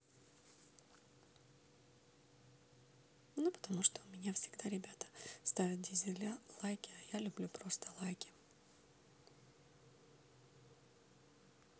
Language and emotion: Russian, neutral